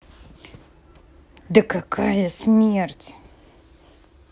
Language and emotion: Russian, angry